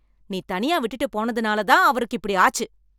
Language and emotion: Tamil, angry